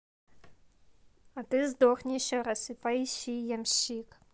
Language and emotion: Russian, neutral